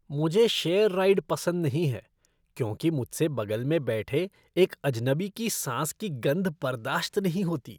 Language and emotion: Hindi, disgusted